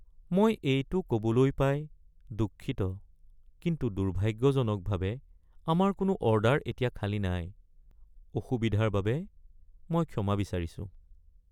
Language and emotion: Assamese, sad